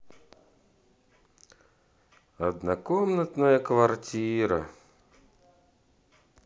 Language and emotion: Russian, neutral